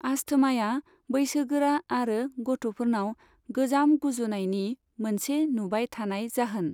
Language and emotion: Bodo, neutral